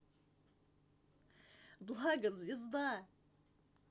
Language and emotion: Russian, positive